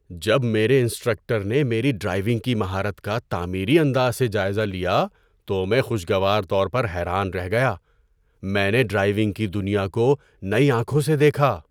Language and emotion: Urdu, surprised